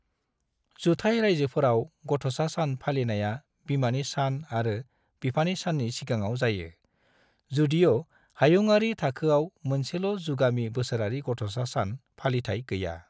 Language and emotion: Bodo, neutral